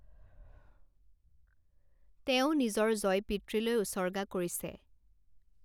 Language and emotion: Assamese, neutral